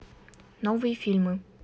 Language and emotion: Russian, neutral